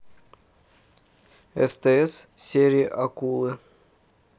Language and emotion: Russian, neutral